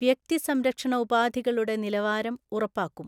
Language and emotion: Malayalam, neutral